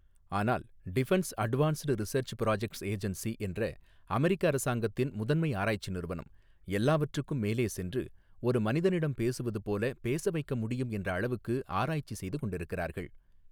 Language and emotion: Tamil, neutral